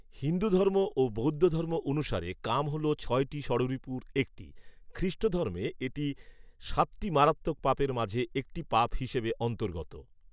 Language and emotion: Bengali, neutral